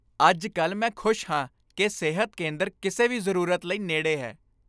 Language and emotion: Punjabi, happy